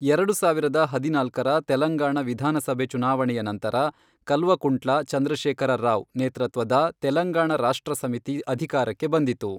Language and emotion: Kannada, neutral